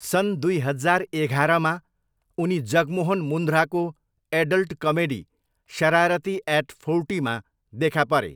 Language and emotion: Nepali, neutral